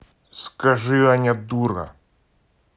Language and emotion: Russian, angry